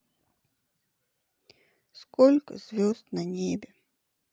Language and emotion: Russian, sad